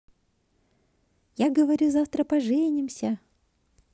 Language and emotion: Russian, positive